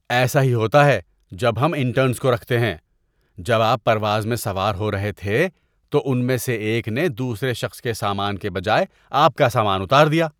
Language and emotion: Urdu, disgusted